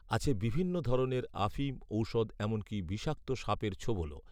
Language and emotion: Bengali, neutral